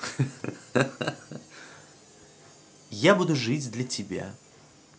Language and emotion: Russian, positive